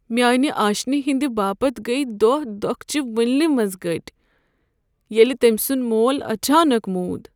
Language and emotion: Kashmiri, sad